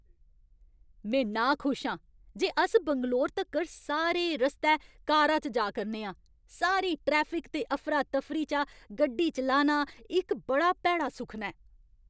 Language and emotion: Dogri, angry